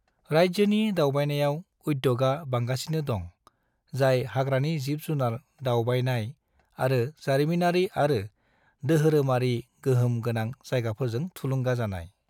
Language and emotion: Bodo, neutral